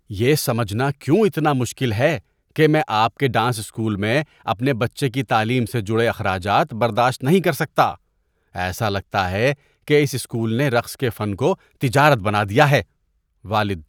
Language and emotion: Urdu, disgusted